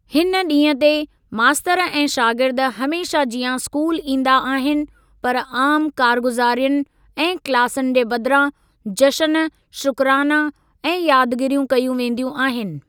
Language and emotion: Sindhi, neutral